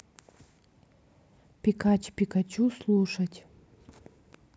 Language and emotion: Russian, neutral